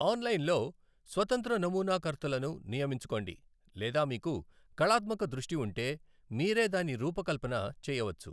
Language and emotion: Telugu, neutral